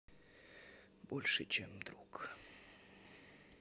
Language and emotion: Russian, sad